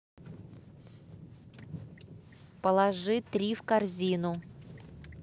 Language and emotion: Russian, angry